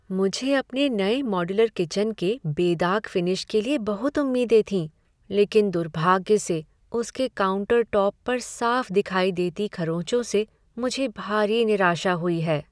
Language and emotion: Hindi, sad